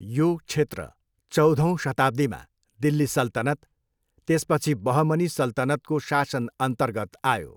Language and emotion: Nepali, neutral